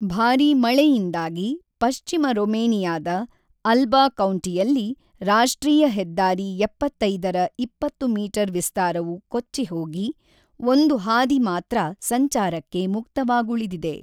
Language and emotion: Kannada, neutral